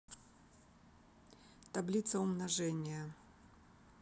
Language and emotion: Russian, neutral